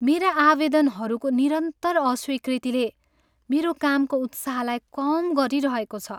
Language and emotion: Nepali, sad